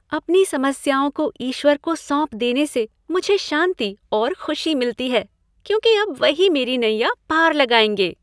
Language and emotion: Hindi, happy